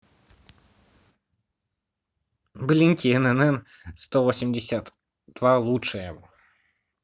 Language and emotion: Russian, neutral